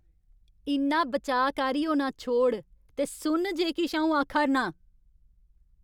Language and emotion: Dogri, angry